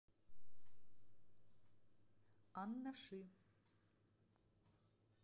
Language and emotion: Russian, neutral